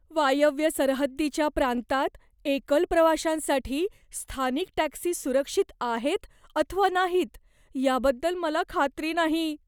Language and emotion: Marathi, fearful